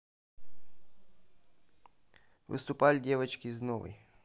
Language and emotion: Russian, neutral